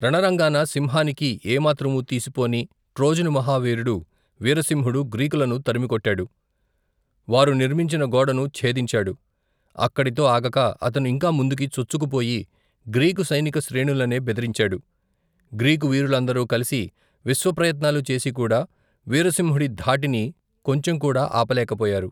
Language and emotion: Telugu, neutral